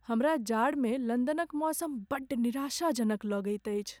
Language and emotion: Maithili, sad